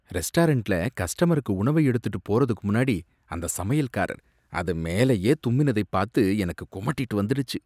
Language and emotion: Tamil, disgusted